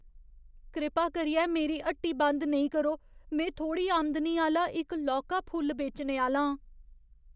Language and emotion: Dogri, fearful